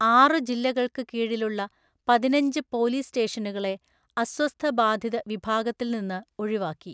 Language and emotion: Malayalam, neutral